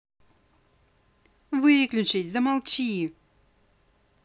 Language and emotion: Russian, angry